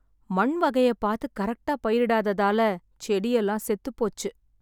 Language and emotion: Tamil, sad